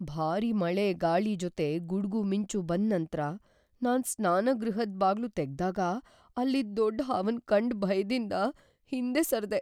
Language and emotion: Kannada, fearful